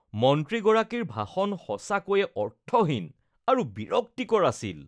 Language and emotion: Assamese, disgusted